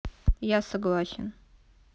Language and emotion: Russian, neutral